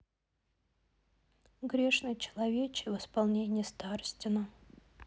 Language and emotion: Russian, sad